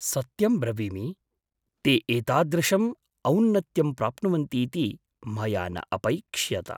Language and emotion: Sanskrit, surprised